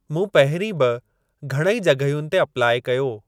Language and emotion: Sindhi, neutral